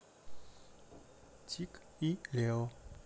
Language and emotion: Russian, neutral